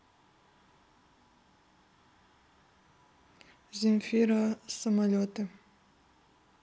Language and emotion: Russian, neutral